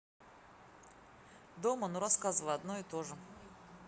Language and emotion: Russian, neutral